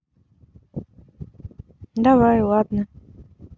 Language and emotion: Russian, neutral